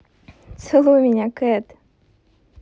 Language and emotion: Russian, positive